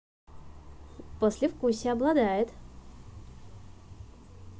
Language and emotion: Russian, positive